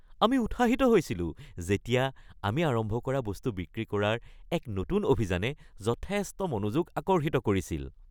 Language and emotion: Assamese, happy